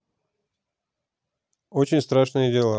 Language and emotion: Russian, neutral